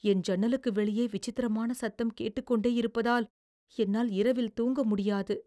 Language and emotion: Tamil, fearful